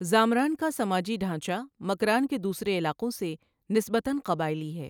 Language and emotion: Urdu, neutral